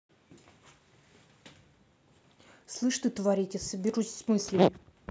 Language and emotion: Russian, angry